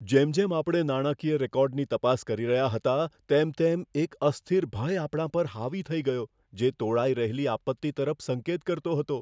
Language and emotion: Gujarati, fearful